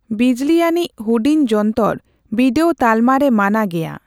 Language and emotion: Santali, neutral